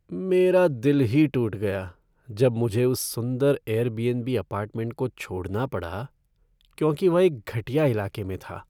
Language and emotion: Hindi, sad